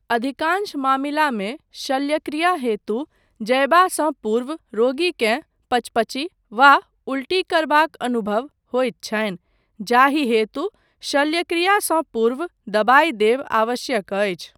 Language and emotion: Maithili, neutral